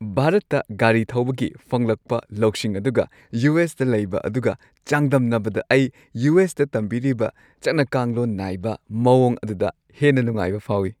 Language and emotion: Manipuri, happy